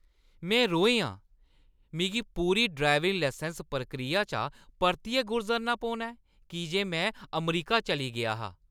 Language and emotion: Dogri, angry